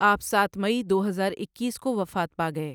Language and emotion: Urdu, neutral